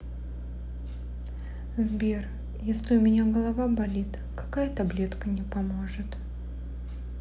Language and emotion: Russian, sad